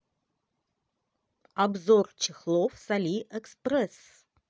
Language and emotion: Russian, positive